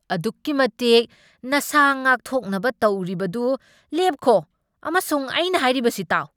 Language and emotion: Manipuri, angry